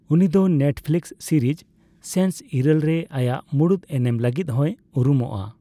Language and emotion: Santali, neutral